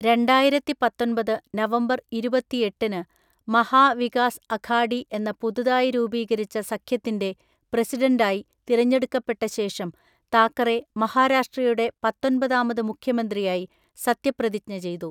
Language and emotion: Malayalam, neutral